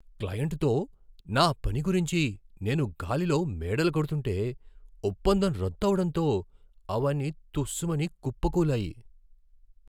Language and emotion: Telugu, surprised